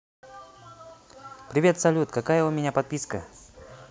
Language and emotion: Russian, positive